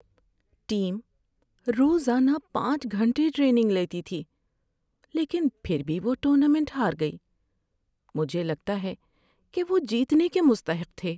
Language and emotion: Urdu, sad